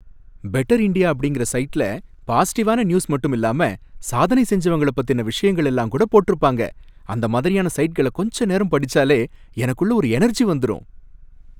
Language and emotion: Tamil, happy